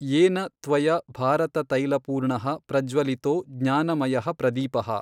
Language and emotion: Kannada, neutral